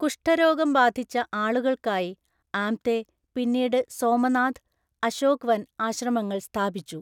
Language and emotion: Malayalam, neutral